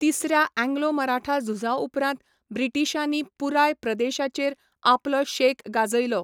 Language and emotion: Goan Konkani, neutral